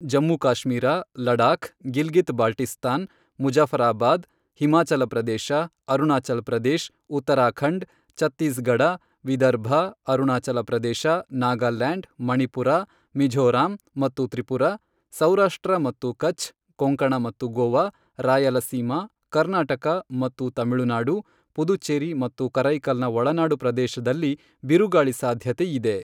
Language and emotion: Kannada, neutral